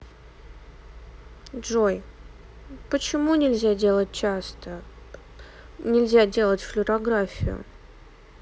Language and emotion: Russian, sad